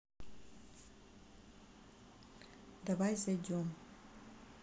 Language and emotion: Russian, neutral